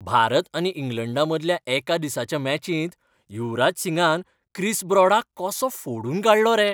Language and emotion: Goan Konkani, happy